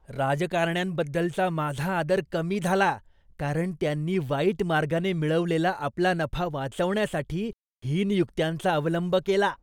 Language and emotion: Marathi, disgusted